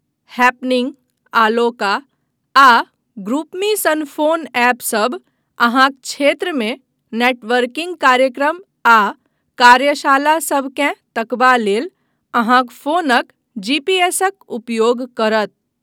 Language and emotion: Maithili, neutral